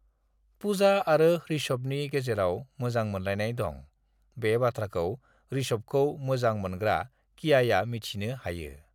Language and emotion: Bodo, neutral